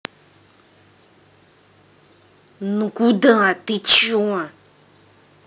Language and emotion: Russian, angry